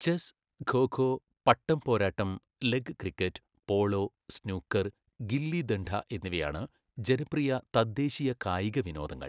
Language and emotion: Malayalam, neutral